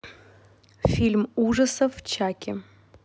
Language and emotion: Russian, neutral